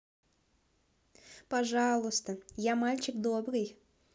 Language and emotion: Russian, positive